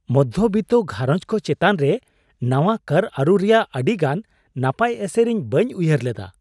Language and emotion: Santali, surprised